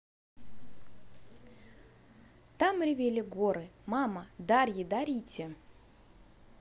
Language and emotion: Russian, positive